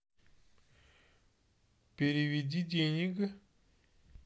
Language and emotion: Russian, neutral